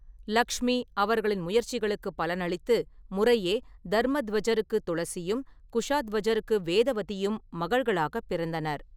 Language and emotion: Tamil, neutral